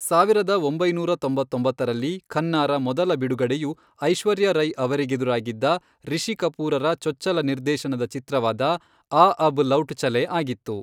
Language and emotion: Kannada, neutral